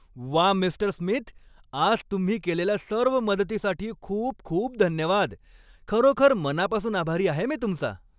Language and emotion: Marathi, happy